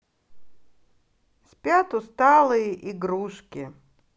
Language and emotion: Russian, neutral